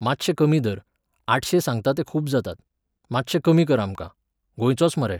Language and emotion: Goan Konkani, neutral